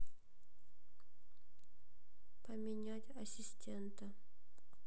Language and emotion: Russian, neutral